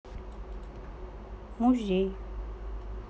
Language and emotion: Russian, neutral